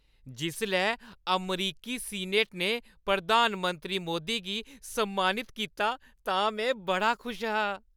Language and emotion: Dogri, happy